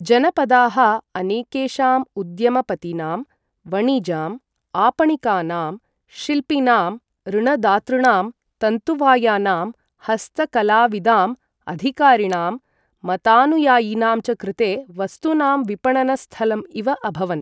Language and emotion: Sanskrit, neutral